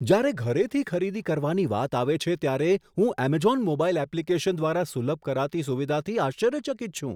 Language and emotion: Gujarati, surprised